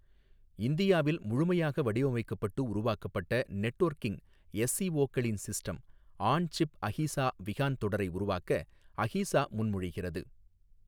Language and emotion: Tamil, neutral